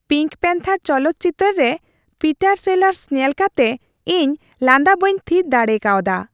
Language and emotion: Santali, happy